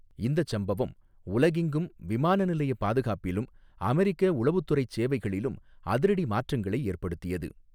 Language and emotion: Tamil, neutral